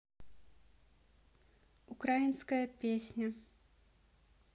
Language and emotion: Russian, neutral